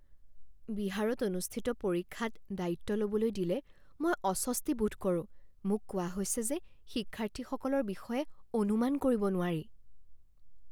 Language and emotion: Assamese, fearful